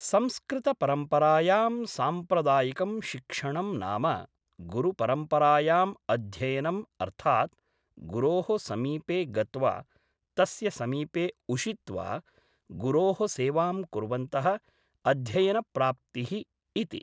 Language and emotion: Sanskrit, neutral